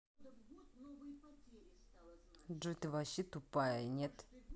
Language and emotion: Russian, angry